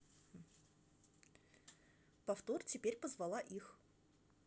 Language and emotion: Russian, neutral